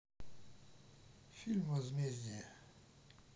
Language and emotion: Russian, neutral